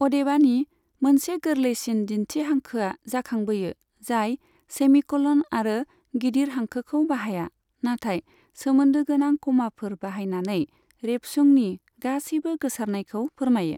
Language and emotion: Bodo, neutral